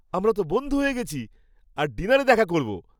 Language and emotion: Bengali, happy